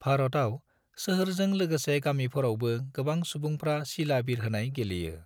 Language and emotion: Bodo, neutral